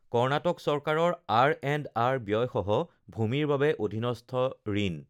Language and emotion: Assamese, neutral